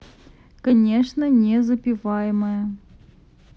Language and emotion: Russian, neutral